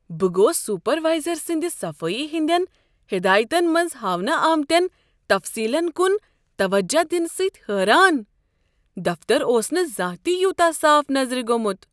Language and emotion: Kashmiri, surprised